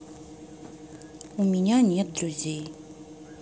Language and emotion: Russian, sad